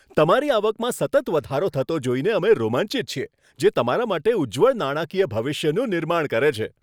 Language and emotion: Gujarati, happy